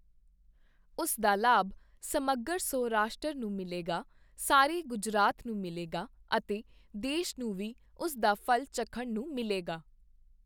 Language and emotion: Punjabi, neutral